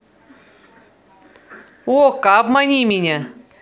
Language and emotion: Russian, positive